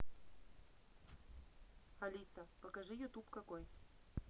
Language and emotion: Russian, neutral